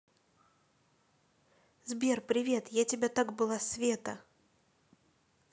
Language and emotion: Russian, positive